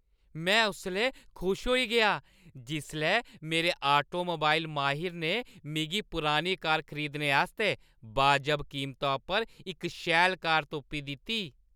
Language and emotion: Dogri, happy